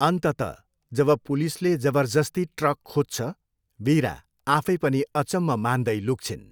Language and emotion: Nepali, neutral